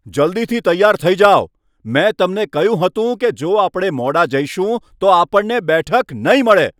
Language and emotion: Gujarati, angry